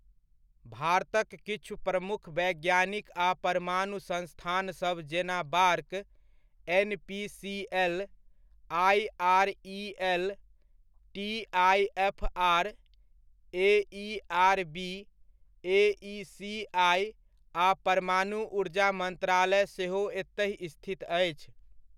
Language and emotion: Maithili, neutral